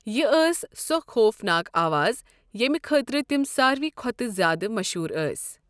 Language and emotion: Kashmiri, neutral